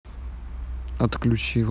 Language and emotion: Russian, neutral